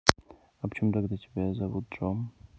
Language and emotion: Russian, neutral